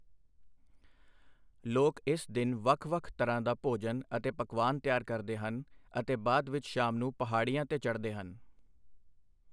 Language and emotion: Punjabi, neutral